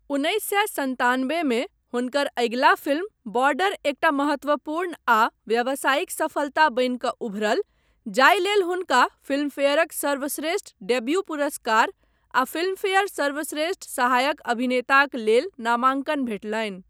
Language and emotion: Maithili, neutral